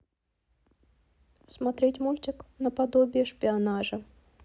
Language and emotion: Russian, neutral